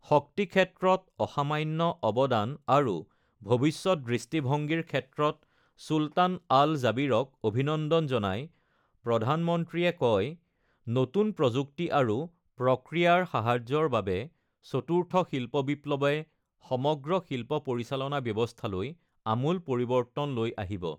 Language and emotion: Assamese, neutral